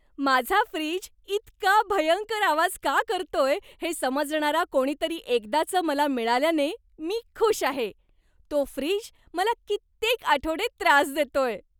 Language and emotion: Marathi, happy